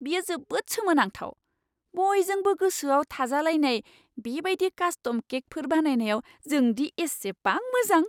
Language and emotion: Bodo, surprised